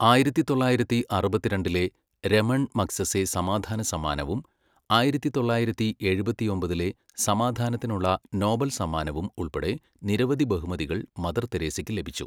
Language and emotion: Malayalam, neutral